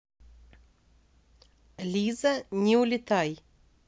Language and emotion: Russian, neutral